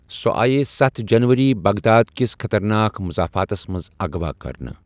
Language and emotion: Kashmiri, neutral